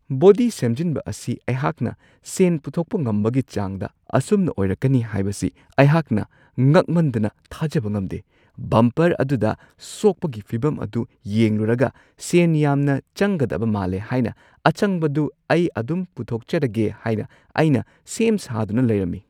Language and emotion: Manipuri, surprised